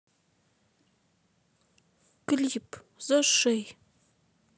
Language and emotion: Russian, sad